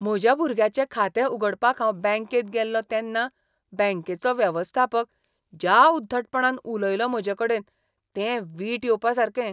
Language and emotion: Goan Konkani, disgusted